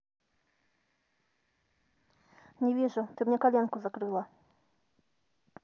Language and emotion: Russian, neutral